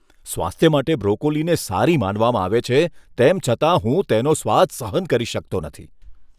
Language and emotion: Gujarati, disgusted